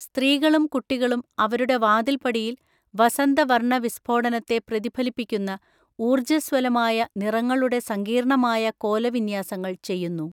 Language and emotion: Malayalam, neutral